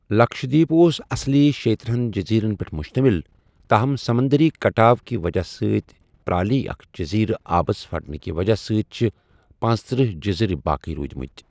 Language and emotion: Kashmiri, neutral